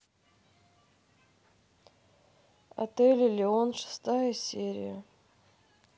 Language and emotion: Russian, neutral